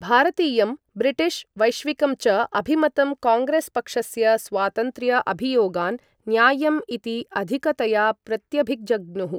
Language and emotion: Sanskrit, neutral